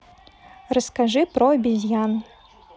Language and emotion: Russian, neutral